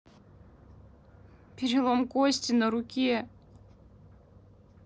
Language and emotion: Russian, sad